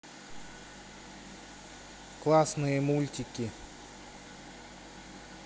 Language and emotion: Russian, neutral